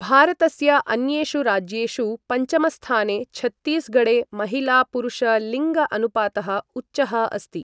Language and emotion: Sanskrit, neutral